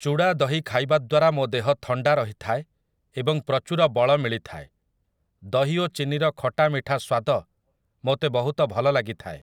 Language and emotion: Odia, neutral